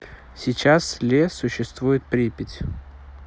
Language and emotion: Russian, neutral